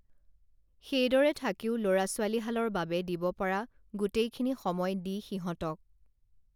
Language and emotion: Assamese, neutral